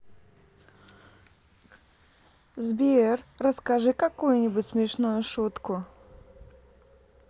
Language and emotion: Russian, positive